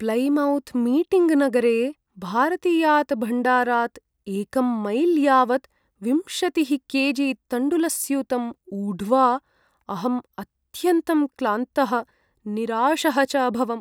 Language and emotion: Sanskrit, sad